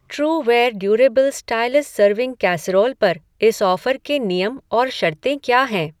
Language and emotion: Hindi, neutral